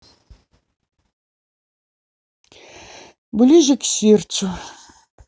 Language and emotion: Russian, sad